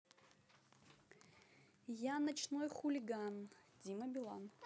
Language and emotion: Russian, neutral